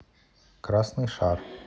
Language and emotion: Russian, neutral